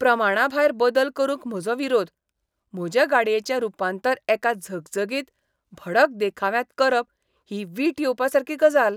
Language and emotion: Goan Konkani, disgusted